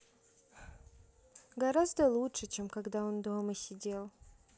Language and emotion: Russian, sad